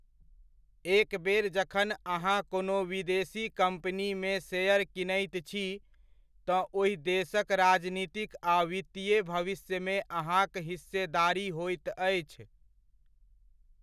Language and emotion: Maithili, neutral